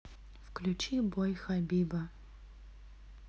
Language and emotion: Russian, neutral